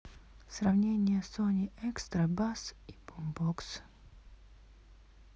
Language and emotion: Russian, neutral